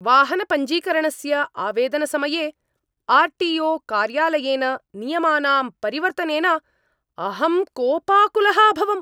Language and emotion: Sanskrit, angry